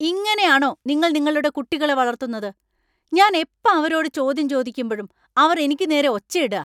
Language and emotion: Malayalam, angry